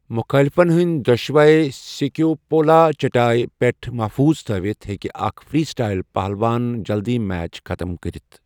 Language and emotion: Kashmiri, neutral